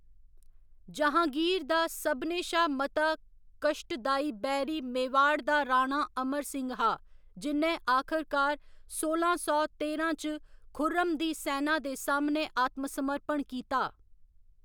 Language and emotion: Dogri, neutral